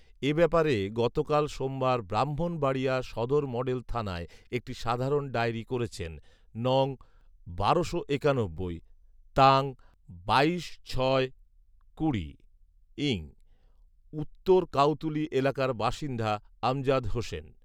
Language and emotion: Bengali, neutral